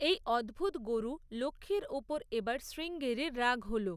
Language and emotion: Bengali, neutral